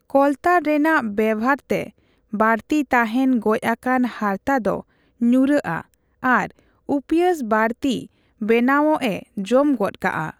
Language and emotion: Santali, neutral